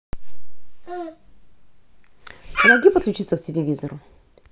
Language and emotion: Russian, neutral